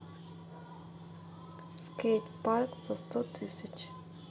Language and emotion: Russian, neutral